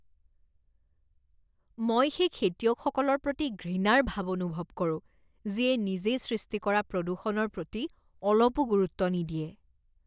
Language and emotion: Assamese, disgusted